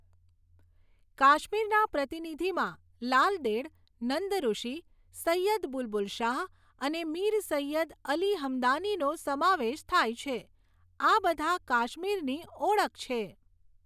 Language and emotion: Gujarati, neutral